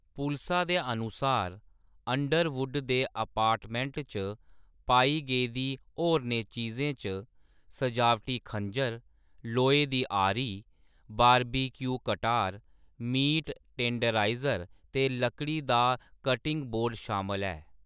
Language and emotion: Dogri, neutral